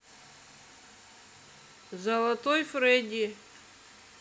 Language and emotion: Russian, neutral